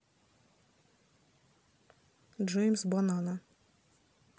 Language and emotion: Russian, neutral